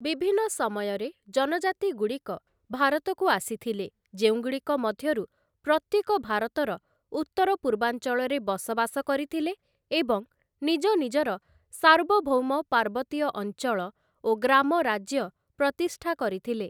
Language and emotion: Odia, neutral